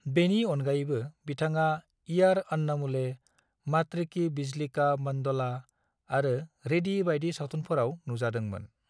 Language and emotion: Bodo, neutral